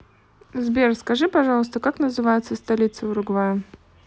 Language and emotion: Russian, neutral